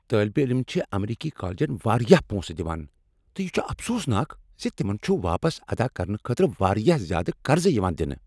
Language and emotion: Kashmiri, angry